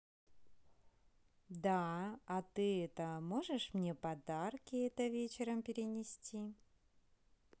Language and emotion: Russian, neutral